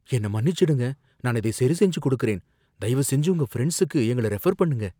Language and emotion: Tamil, fearful